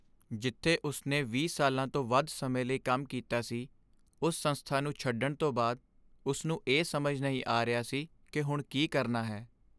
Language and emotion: Punjabi, sad